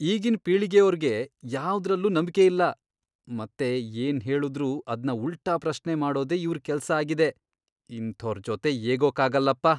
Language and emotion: Kannada, disgusted